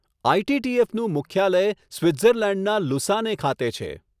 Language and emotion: Gujarati, neutral